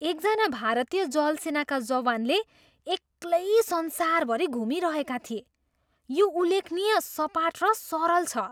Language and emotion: Nepali, surprised